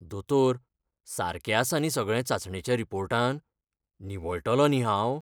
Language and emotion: Goan Konkani, fearful